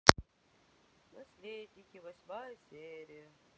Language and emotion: Russian, sad